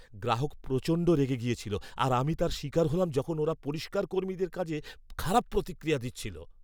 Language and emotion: Bengali, angry